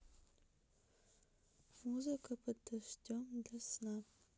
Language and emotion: Russian, neutral